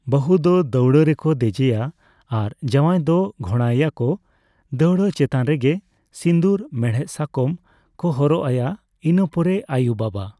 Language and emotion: Santali, neutral